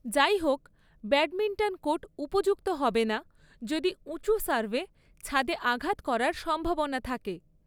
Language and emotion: Bengali, neutral